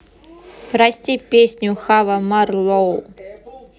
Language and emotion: Russian, neutral